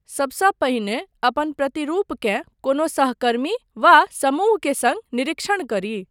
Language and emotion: Maithili, neutral